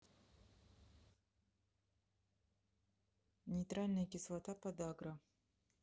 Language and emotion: Russian, neutral